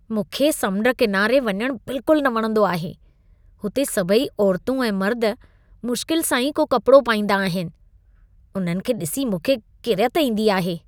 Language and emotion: Sindhi, disgusted